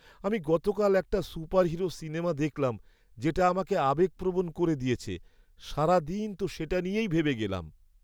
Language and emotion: Bengali, sad